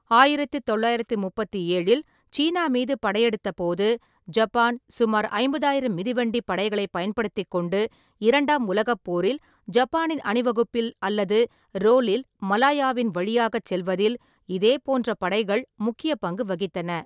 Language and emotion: Tamil, neutral